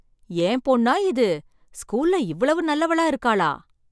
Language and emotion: Tamil, surprised